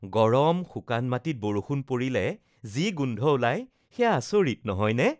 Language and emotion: Assamese, happy